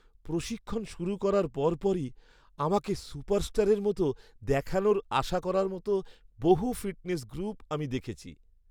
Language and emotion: Bengali, sad